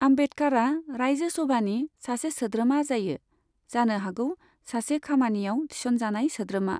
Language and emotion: Bodo, neutral